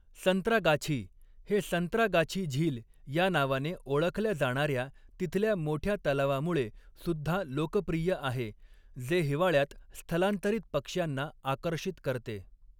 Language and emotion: Marathi, neutral